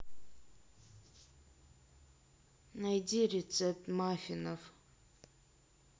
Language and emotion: Russian, sad